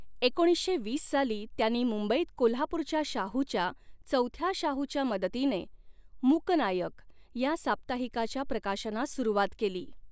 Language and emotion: Marathi, neutral